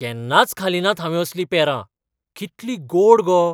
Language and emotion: Goan Konkani, surprised